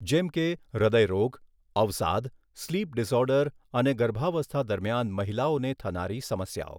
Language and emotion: Gujarati, neutral